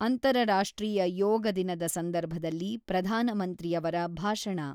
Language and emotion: Kannada, neutral